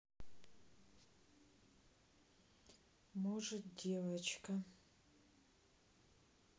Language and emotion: Russian, sad